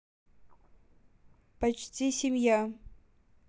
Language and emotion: Russian, neutral